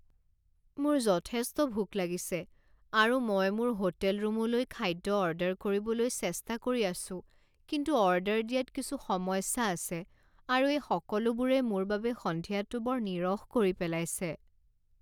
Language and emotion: Assamese, sad